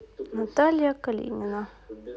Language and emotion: Russian, neutral